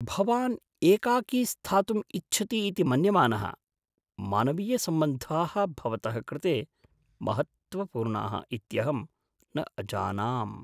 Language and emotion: Sanskrit, surprised